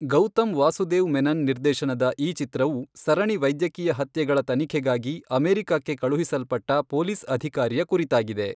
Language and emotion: Kannada, neutral